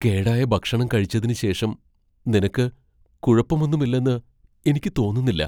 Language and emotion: Malayalam, fearful